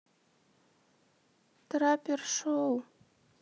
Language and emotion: Russian, sad